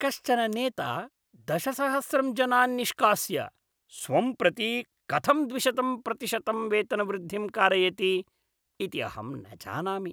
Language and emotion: Sanskrit, disgusted